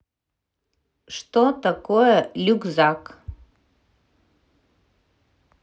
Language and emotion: Russian, neutral